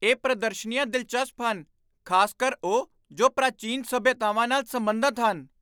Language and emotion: Punjabi, surprised